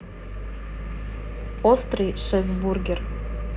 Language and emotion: Russian, neutral